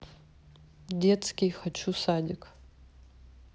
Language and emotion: Russian, neutral